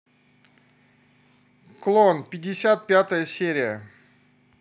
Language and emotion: Russian, positive